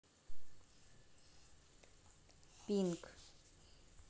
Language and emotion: Russian, neutral